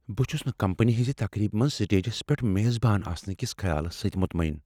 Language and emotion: Kashmiri, fearful